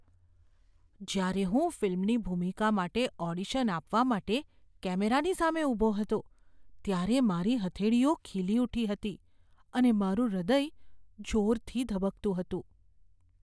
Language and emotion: Gujarati, fearful